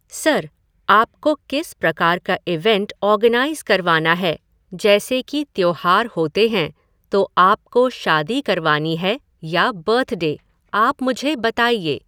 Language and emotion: Hindi, neutral